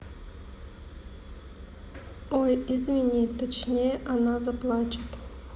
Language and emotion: Russian, neutral